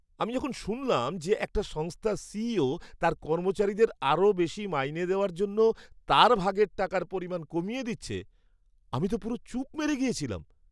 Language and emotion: Bengali, surprised